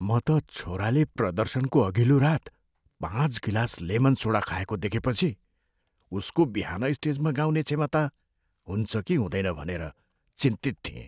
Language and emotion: Nepali, fearful